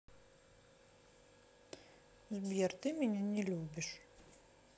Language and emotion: Russian, sad